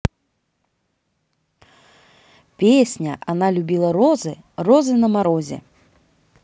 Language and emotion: Russian, positive